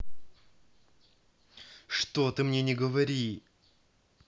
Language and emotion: Russian, angry